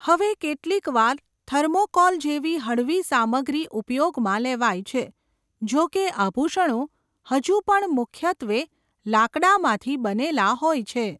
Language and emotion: Gujarati, neutral